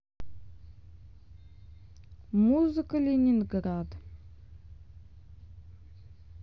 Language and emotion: Russian, neutral